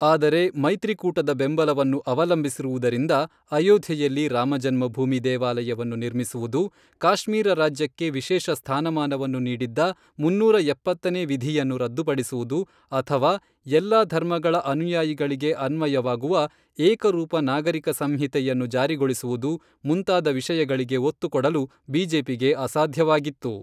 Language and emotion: Kannada, neutral